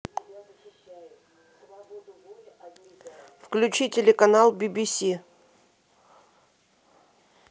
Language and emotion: Russian, neutral